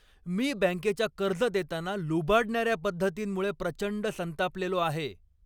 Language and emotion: Marathi, angry